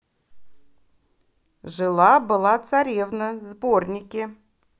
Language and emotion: Russian, positive